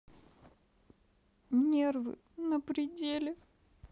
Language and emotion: Russian, sad